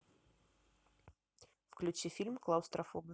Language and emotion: Russian, neutral